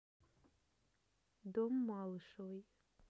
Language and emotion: Russian, neutral